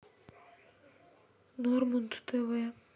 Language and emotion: Russian, sad